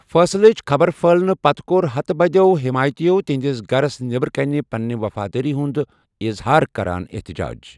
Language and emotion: Kashmiri, neutral